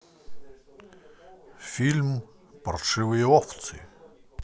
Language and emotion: Russian, positive